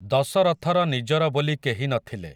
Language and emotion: Odia, neutral